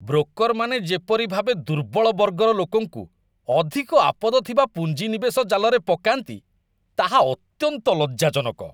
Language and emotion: Odia, disgusted